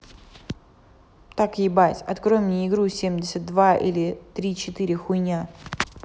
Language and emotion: Russian, angry